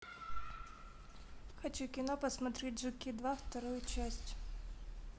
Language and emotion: Russian, neutral